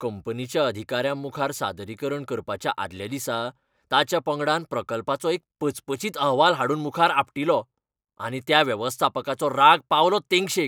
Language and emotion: Goan Konkani, angry